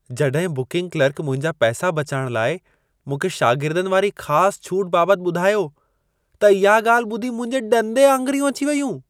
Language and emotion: Sindhi, surprised